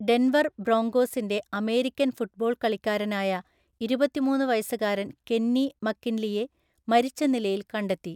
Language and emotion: Malayalam, neutral